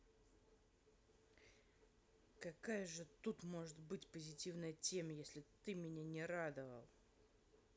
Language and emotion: Russian, angry